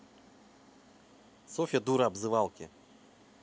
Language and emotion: Russian, neutral